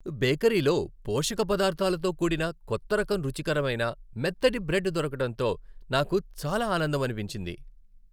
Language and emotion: Telugu, happy